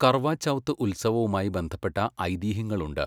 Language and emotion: Malayalam, neutral